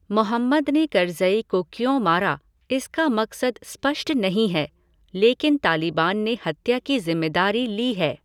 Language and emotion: Hindi, neutral